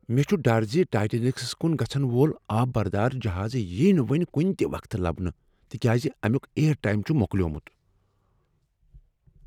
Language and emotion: Kashmiri, fearful